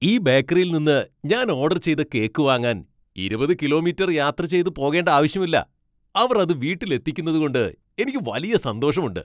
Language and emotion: Malayalam, happy